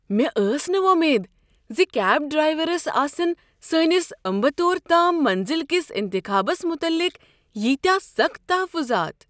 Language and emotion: Kashmiri, surprised